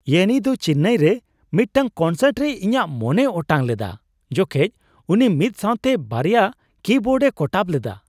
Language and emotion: Santali, surprised